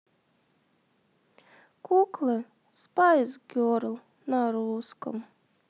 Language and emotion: Russian, sad